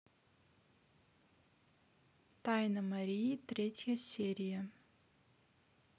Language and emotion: Russian, neutral